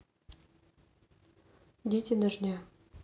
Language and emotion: Russian, neutral